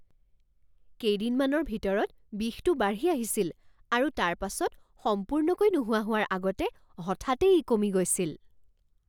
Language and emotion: Assamese, surprised